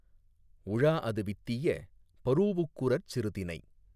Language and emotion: Tamil, neutral